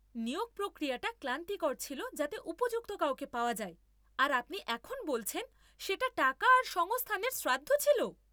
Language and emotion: Bengali, angry